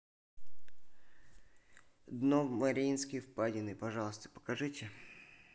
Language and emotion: Russian, neutral